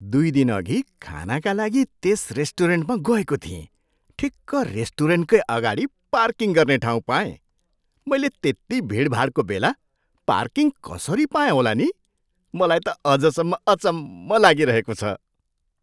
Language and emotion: Nepali, surprised